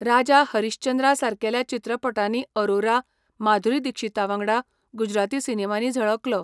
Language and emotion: Goan Konkani, neutral